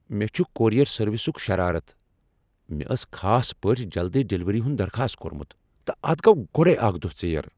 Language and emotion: Kashmiri, angry